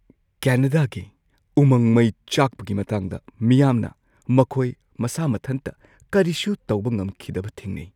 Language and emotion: Manipuri, fearful